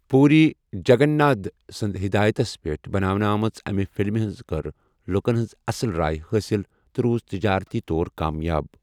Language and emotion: Kashmiri, neutral